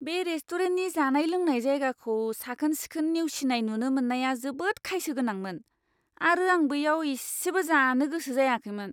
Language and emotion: Bodo, disgusted